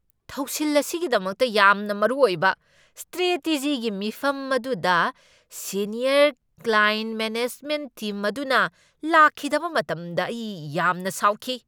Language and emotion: Manipuri, angry